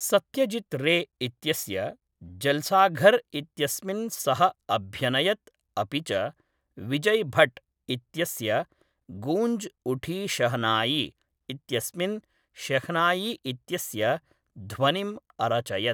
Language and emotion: Sanskrit, neutral